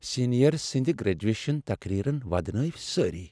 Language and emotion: Kashmiri, sad